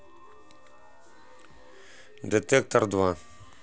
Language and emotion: Russian, neutral